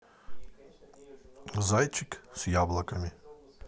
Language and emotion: Russian, neutral